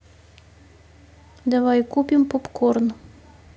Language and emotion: Russian, neutral